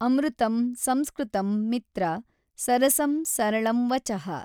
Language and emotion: Kannada, neutral